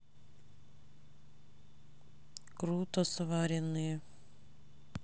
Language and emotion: Russian, neutral